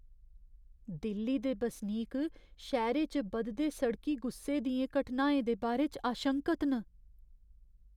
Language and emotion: Dogri, fearful